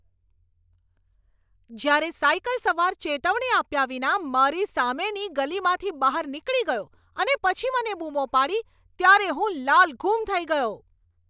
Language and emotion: Gujarati, angry